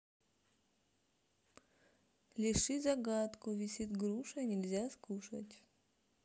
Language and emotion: Russian, neutral